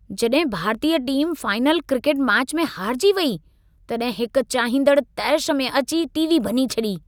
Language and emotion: Sindhi, angry